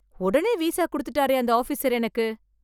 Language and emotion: Tamil, surprised